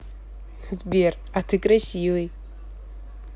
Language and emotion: Russian, positive